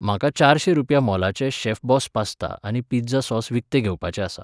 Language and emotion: Goan Konkani, neutral